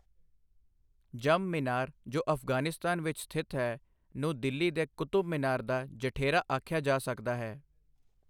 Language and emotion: Punjabi, neutral